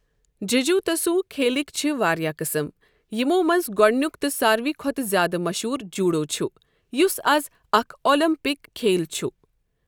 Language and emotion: Kashmiri, neutral